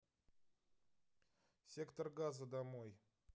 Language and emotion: Russian, neutral